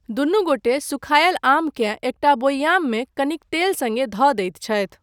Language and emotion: Maithili, neutral